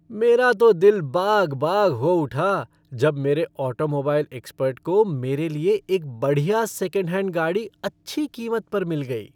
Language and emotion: Hindi, happy